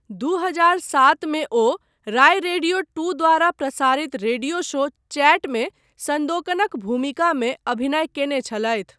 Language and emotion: Maithili, neutral